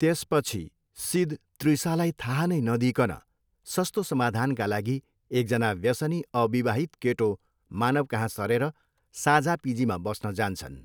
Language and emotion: Nepali, neutral